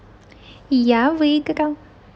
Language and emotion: Russian, positive